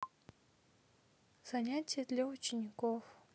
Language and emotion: Russian, neutral